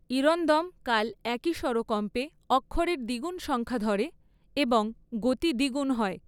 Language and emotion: Bengali, neutral